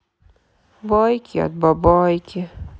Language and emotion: Russian, sad